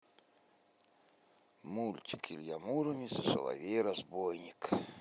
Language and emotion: Russian, neutral